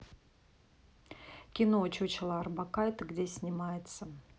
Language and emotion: Russian, neutral